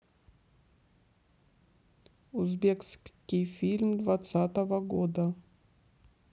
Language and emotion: Russian, neutral